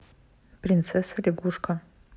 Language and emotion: Russian, neutral